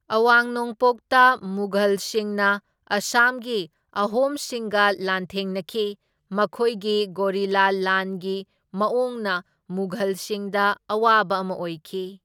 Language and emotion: Manipuri, neutral